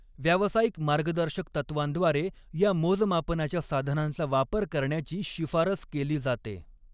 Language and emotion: Marathi, neutral